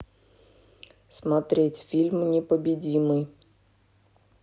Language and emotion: Russian, neutral